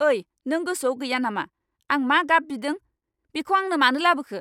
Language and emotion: Bodo, angry